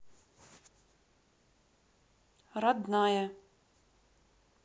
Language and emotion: Russian, neutral